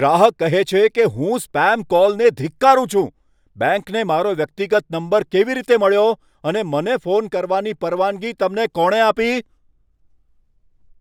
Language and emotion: Gujarati, angry